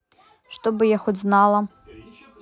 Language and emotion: Russian, neutral